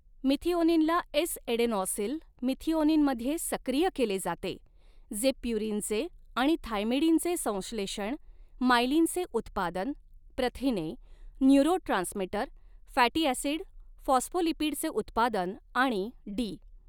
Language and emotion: Marathi, neutral